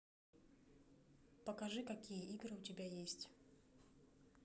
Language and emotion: Russian, neutral